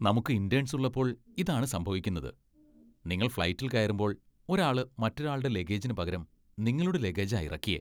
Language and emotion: Malayalam, disgusted